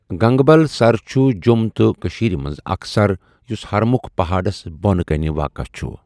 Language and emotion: Kashmiri, neutral